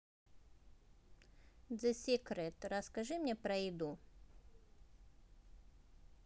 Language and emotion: Russian, neutral